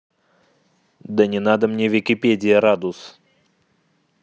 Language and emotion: Russian, angry